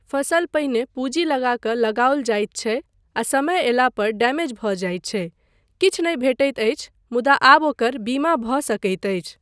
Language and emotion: Maithili, neutral